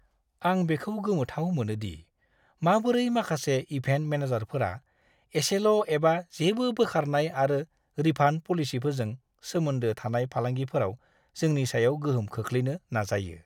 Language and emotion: Bodo, disgusted